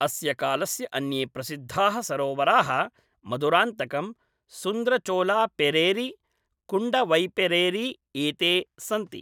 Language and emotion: Sanskrit, neutral